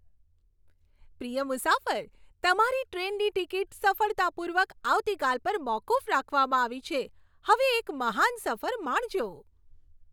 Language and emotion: Gujarati, happy